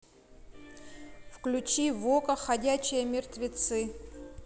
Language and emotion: Russian, neutral